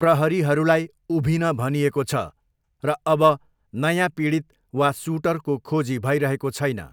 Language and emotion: Nepali, neutral